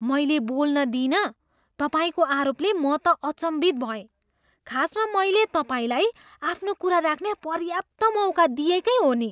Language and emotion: Nepali, surprised